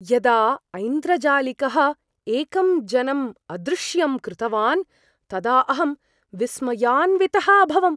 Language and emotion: Sanskrit, surprised